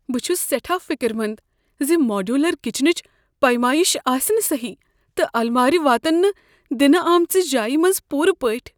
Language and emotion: Kashmiri, fearful